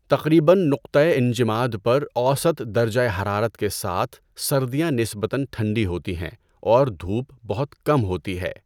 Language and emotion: Urdu, neutral